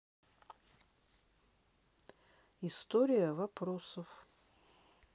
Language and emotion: Russian, neutral